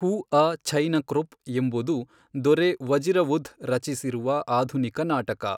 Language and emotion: Kannada, neutral